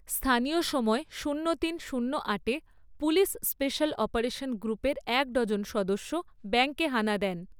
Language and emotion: Bengali, neutral